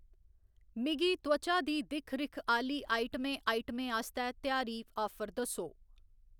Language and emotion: Dogri, neutral